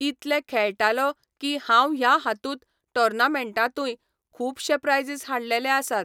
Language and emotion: Goan Konkani, neutral